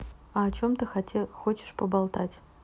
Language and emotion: Russian, neutral